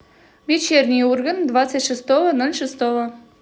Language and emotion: Russian, positive